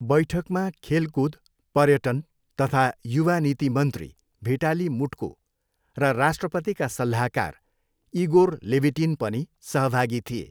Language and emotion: Nepali, neutral